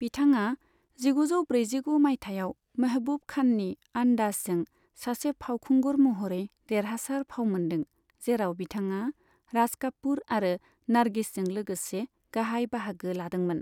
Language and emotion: Bodo, neutral